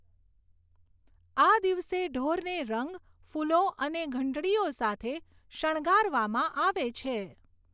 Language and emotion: Gujarati, neutral